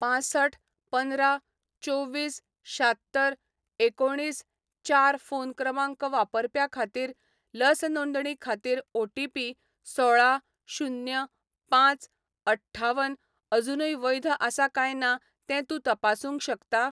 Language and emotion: Goan Konkani, neutral